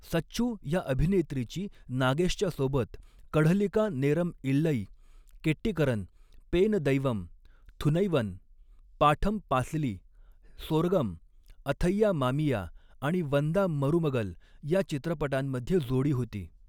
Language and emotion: Marathi, neutral